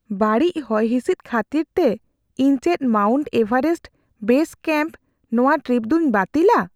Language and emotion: Santali, fearful